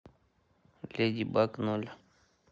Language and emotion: Russian, neutral